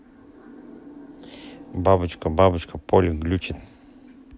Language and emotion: Russian, neutral